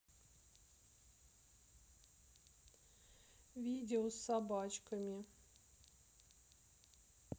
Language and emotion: Russian, sad